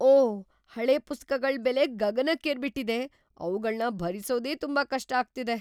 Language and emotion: Kannada, surprised